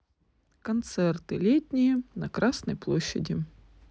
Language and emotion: Russian, neutral